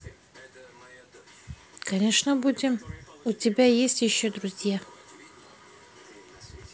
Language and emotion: Russian, neutral